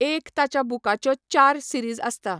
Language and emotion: Goan Konkani, neutral